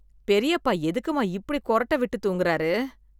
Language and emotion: Tamil, disgusted